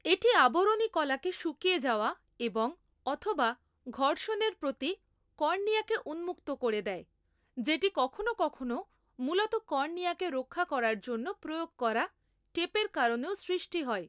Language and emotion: Bengali, neutral